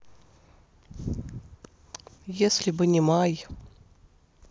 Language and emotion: Russian, sad